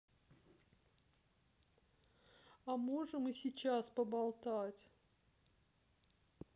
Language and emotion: Russian, sad